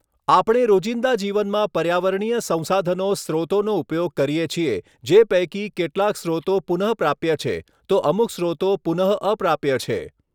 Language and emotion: Gujarati, neutral